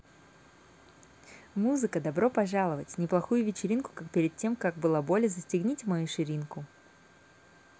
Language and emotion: Russian, positive